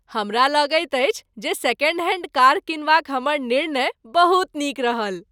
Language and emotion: Maithili, happy